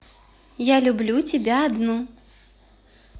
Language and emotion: Russian, positive